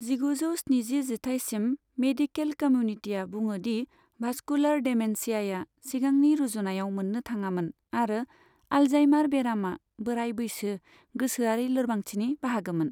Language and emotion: Bodo, neutral